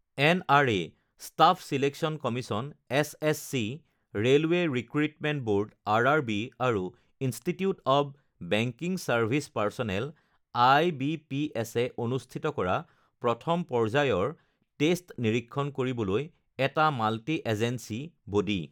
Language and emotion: Assamese, neutral